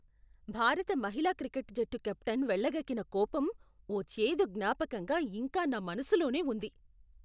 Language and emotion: Telugu, disgusted